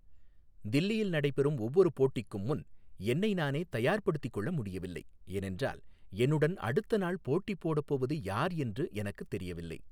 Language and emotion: Tamil, neutral